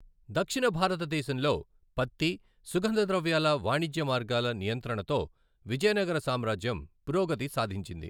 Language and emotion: Telugu, neutral